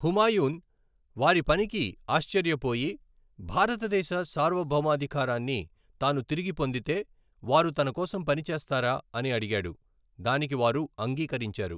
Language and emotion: Telugu, neutral